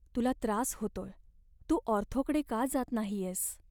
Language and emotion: Marathi, sad